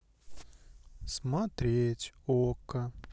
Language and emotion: Russian, sad